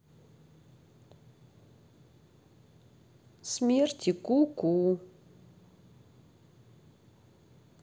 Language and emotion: Russian, sad